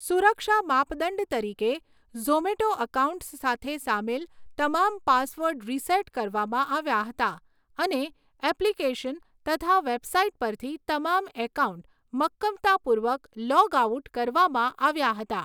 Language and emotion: Gujarati, neutral